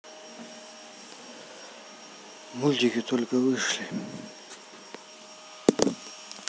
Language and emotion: Russian, sad